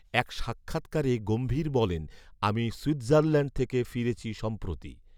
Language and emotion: Bengali, neutral